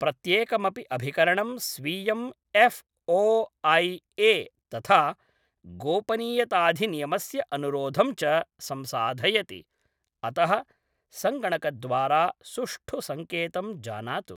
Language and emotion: Sanskrit, neutral